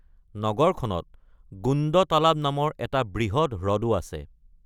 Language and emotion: Assamese, neutral